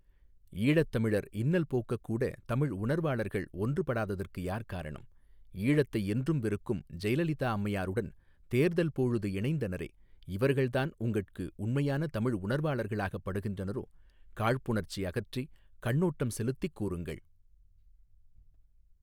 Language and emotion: Tamil, neutral